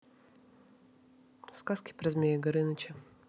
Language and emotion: Russian, neutral